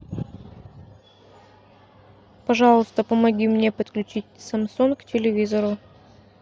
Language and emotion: Russian, neutral